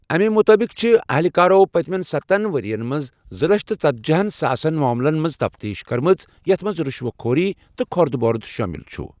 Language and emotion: Kashmiri, neutral